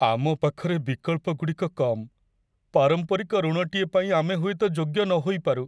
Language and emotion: Odia, sad